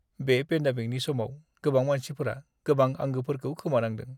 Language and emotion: Bodo, sad